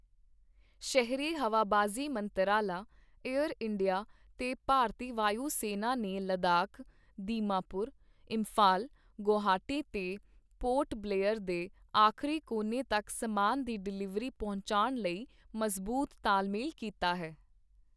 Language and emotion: Punjabi, neutral